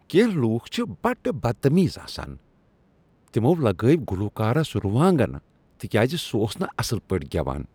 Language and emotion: Kashmiri, disgusted